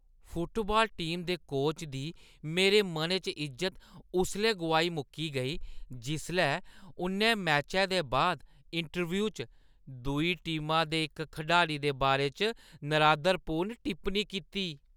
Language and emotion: Dogri, disgusted